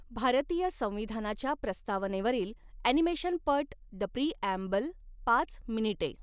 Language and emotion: Marathi, neutral